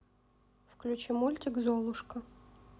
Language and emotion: Russian, neutral